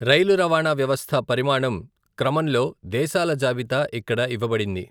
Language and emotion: Telugu, neutral